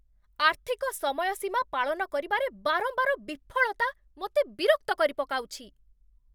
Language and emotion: Odia, angry